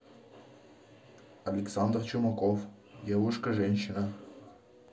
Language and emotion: Russian, neutral